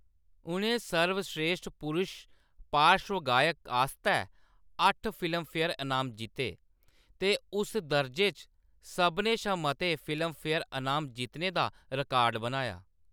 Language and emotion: Dogri, neutral